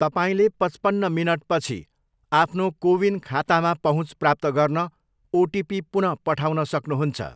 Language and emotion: Nepali, neutral